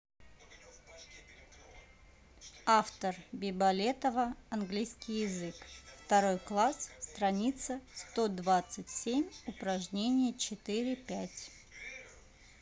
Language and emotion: Russian, neutral